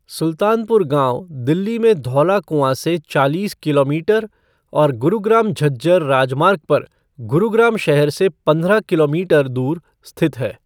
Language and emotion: Hindi, neutral